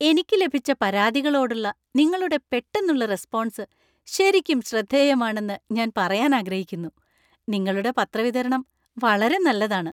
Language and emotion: Malayalam, happy